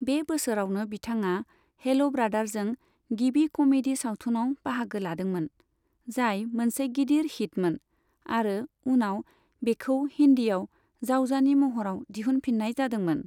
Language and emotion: Bodo, neutral